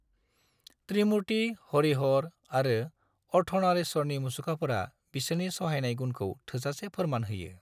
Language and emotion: Bodo, neutral